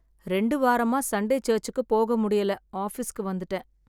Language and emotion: Tamil, sad